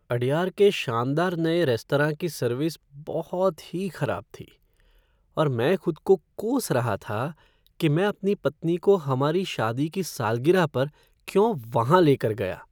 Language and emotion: Hindi, sad